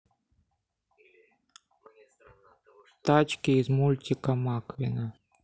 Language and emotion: Russian, neutral